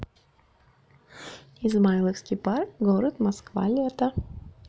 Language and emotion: Russian, neutral